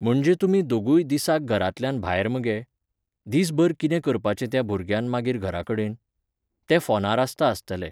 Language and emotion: Goan Konkani, neutral